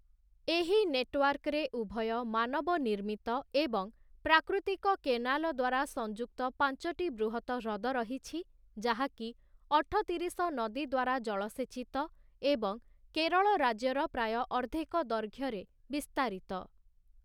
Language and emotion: Odia, neutral